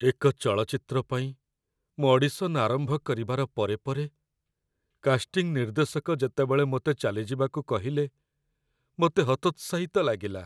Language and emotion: Odia, sad